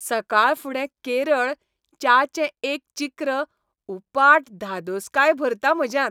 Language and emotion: Goan Konkani, happy